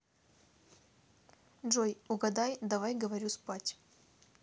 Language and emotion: Russian, neutral